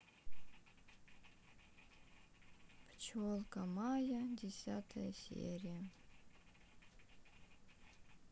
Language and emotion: Russian, sad